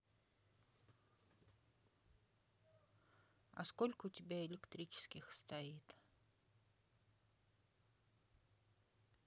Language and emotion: Russian, sad